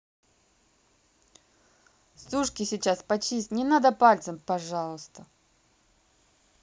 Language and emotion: Russian, neutral